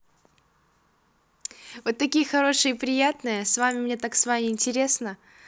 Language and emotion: Russian, positive